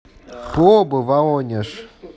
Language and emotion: Russian, neutral